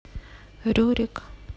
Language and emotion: Russian, sad